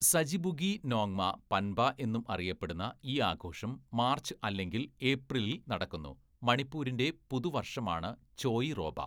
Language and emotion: Malayalam, neutral